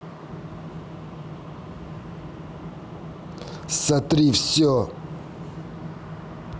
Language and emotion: Russian, angry